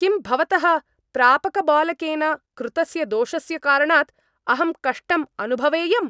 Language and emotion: Sanskrit, angry